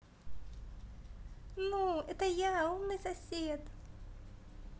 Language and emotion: Russian, positive